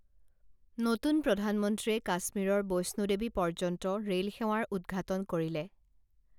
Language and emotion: Assamese, neutral